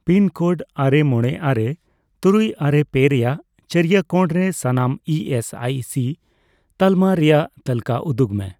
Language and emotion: Santali, neutral